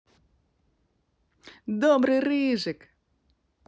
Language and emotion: Russian, positive